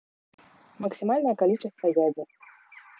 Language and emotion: Russian, neutral